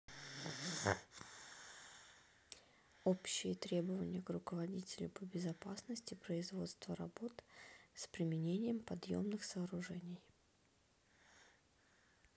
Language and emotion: Russian, neutral